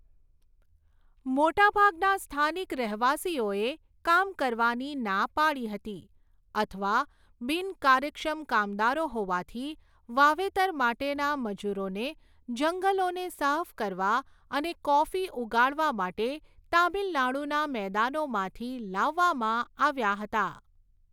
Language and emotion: Gujarati, neutral